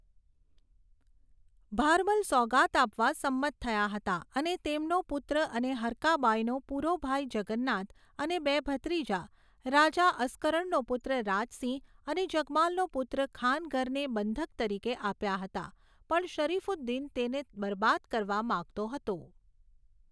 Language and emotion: Gujarati, neutral